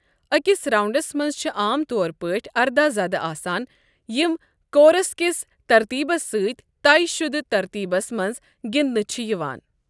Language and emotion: Kashmiri, neutral